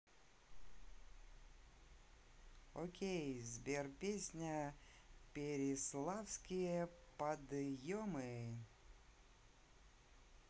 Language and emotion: Russian, positive